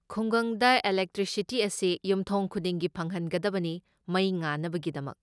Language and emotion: Manipuri, neutral